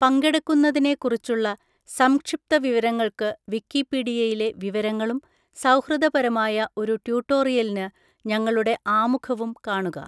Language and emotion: Malayalam, neutral